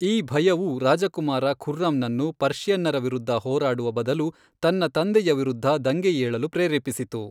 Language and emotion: Kannada, neutral